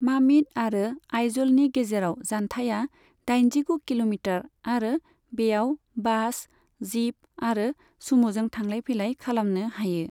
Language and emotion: Bodo, neutral